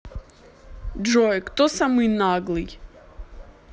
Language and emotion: Russian, neutral